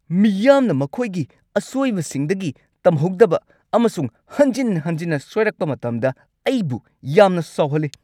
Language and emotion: Manipuri, angry